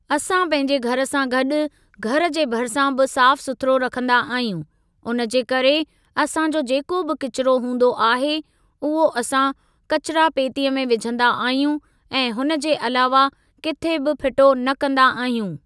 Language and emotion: Sindhi, neutral